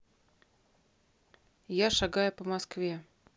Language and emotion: Russian, neutral